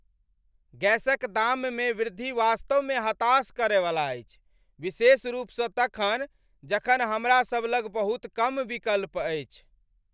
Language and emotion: Maithili, angry